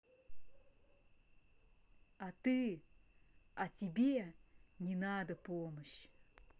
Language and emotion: Russian, angry